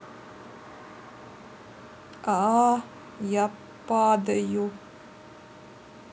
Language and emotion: Russian, neutral